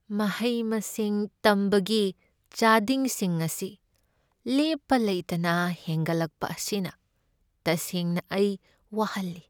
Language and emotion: Manipuri, sad